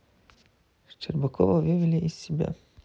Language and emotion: Russian, sad